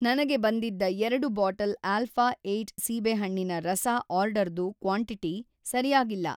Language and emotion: Kannada, neutral